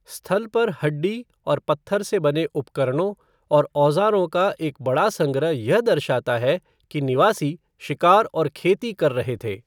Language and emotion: Hindi, neutral